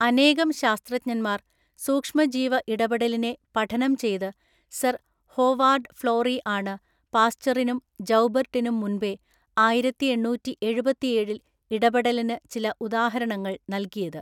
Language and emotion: Malayalam, neutral